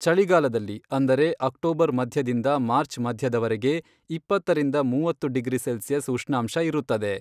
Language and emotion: Kannada, neutral